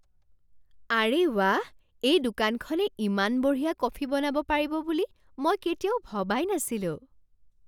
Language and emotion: Assamese, surprised